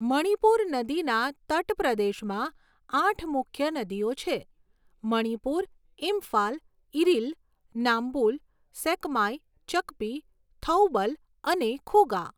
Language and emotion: Gujarati, neutral